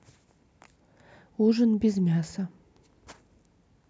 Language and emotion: Russian, neutral